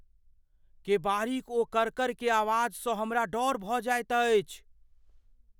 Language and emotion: Maithili, fearful